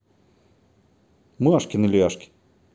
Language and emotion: Russian, neutral